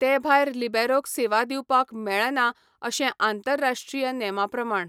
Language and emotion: Goan Konkani, neutral